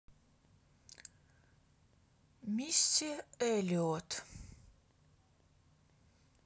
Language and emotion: Russian, neutral